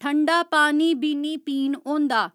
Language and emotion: Dogri, neutral